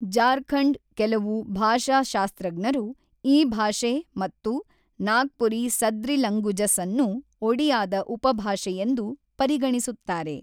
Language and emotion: Kannada, neutral